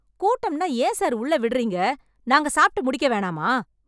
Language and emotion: Tamil, angry